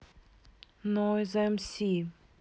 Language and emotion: Russian, neutral